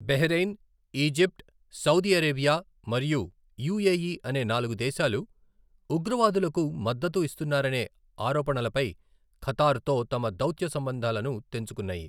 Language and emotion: Telugu, neutral